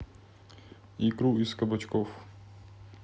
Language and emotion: Russian, neutral